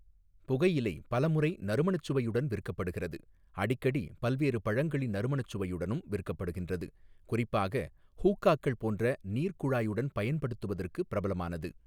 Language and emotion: Tamil, neutral